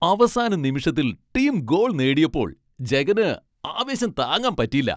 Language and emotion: Malayalam, happy